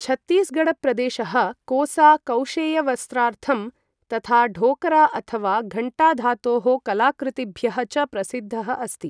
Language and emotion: Sanskrit, neutral